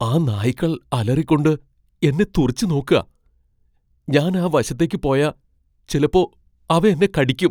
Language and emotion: Malayalam, fearful